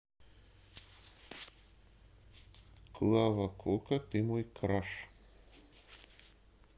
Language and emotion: Russian, neutral